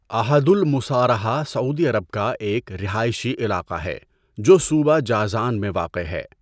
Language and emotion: Urdu, neutral